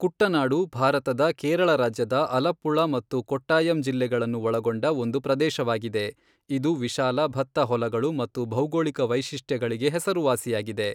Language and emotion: Kannada, neutral